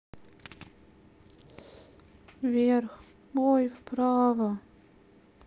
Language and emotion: Russian, sad